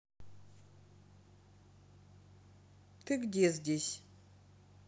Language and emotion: Russian, neutral